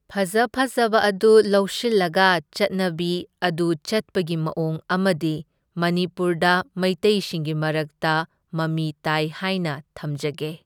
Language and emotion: Manipuri, neutral